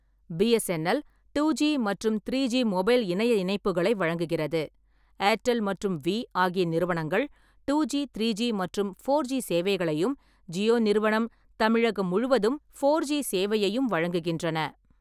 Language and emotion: Tamil, neutral